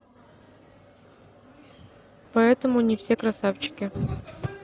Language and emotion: Russian, neutral